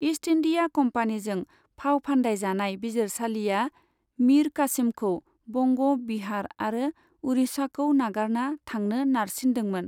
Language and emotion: Bodo, neutral